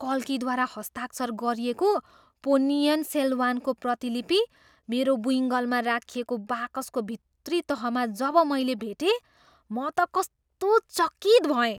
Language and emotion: Nepali, surprised